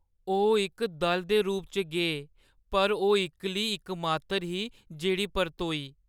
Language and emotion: Dogri, sad